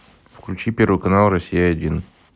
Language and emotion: Russian, neutral